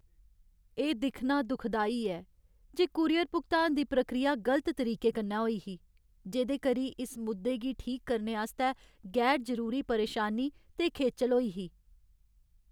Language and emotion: Dogri, sad